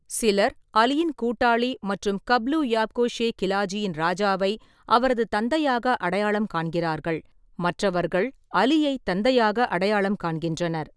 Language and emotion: Tamil, neutral